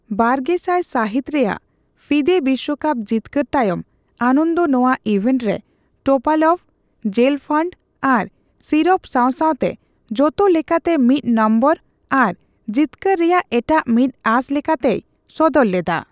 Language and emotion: Santali, neutral